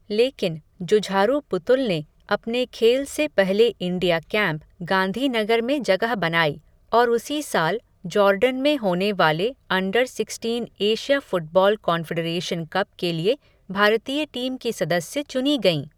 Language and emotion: Hindi, neutral